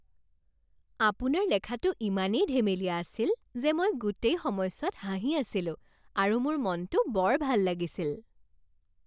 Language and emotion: Assamese, happy